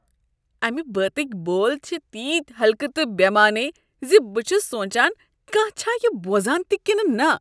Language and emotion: Kashmiri, disgusted